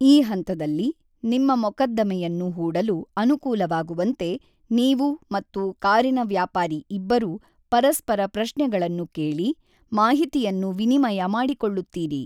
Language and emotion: Kannada, neutral